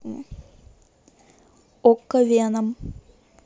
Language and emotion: Russian, neutral